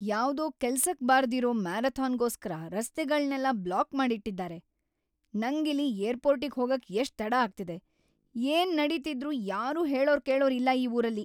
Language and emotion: Kannada, angry